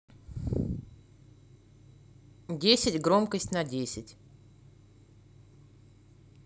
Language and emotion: Russian, neutral